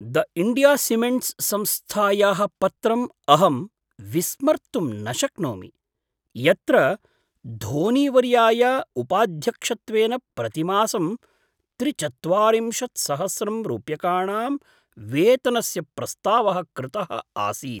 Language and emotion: Sanskrit, surprised